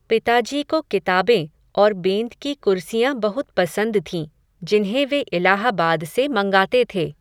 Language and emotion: Hindi, neutral